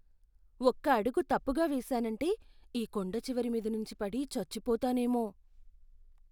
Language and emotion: Telugu, fearful